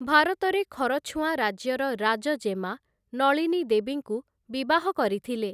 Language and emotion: Odia, neutral